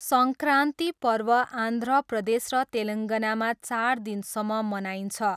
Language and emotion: Nepali, neutral